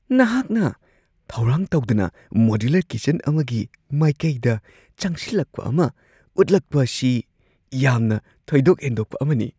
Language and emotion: Manipuri, surprised